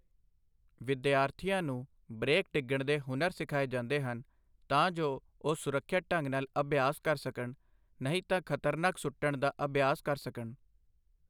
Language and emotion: Punjabi, neutral